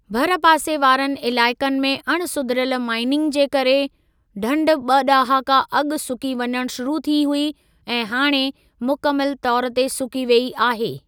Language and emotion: Sindhi, neutral